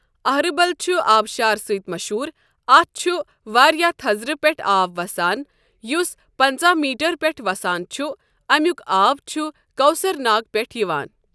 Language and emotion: Kashmiri, neutral